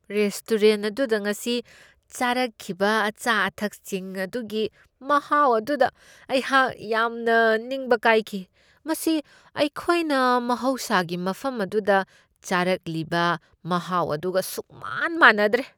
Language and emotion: Manipuri, disgusted